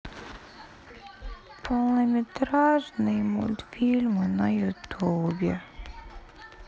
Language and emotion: Russian, sad